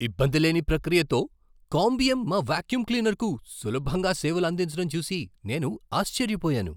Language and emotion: Telugu, surprised